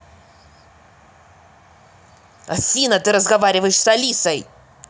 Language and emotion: Russian, angry